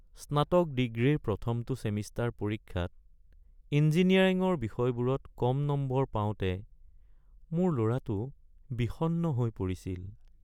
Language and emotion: Assamese, sad